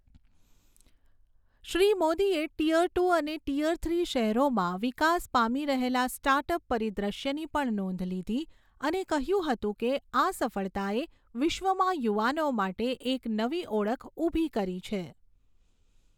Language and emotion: Gujarati, neutral